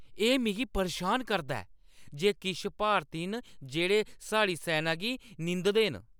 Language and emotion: Dogri, angry